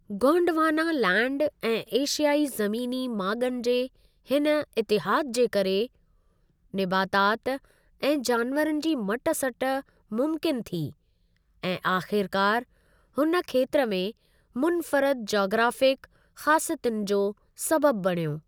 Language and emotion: Sindhi, neutral